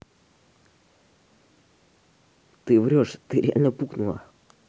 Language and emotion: Russian, angry